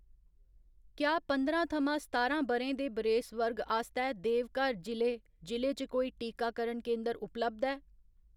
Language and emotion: Dogri, neutral